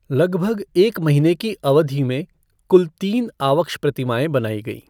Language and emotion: Hindi, neutral